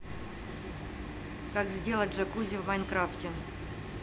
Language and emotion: Russian, neutral